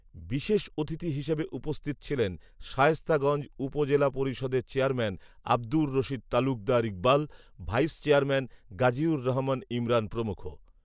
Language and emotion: Bengali, neutral